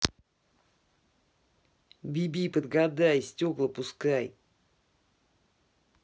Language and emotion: Russian, angry